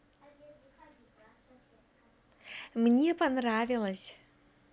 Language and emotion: Russian, positive